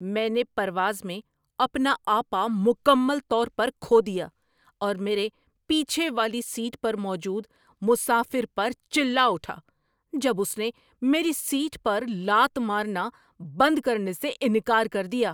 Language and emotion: Urdu, angry